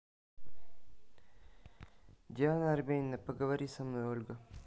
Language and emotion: Russian, neutral